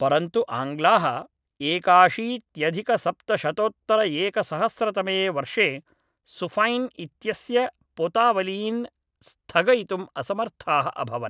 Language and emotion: Sanskrit, neutral